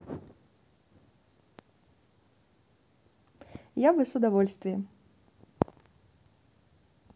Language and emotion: Russian, positive